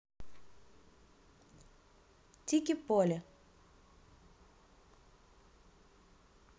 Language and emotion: Russian, neutral